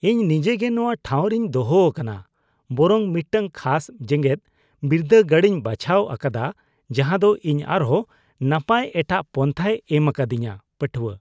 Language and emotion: Santali, disgusted